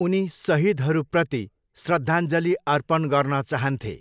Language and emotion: Nepali, neutral